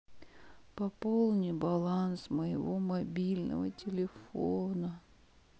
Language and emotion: Russian, sad